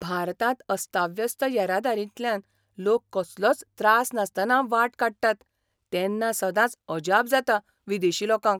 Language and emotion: Goan Konkani, surprised